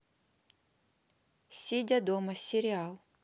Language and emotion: Russian, neutral